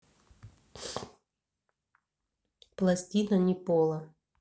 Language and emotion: Russian, neutral